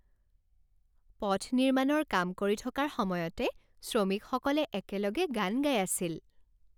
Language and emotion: Assamese, happy